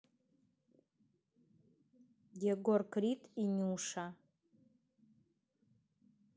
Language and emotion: Russian, neutral